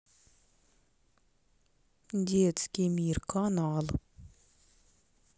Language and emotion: Russian, neutral